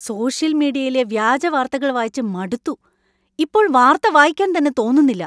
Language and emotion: Malayalam, angry